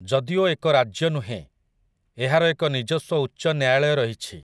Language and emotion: Odia, neutral